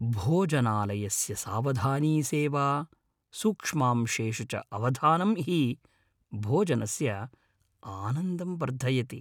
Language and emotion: Sanskrit, happy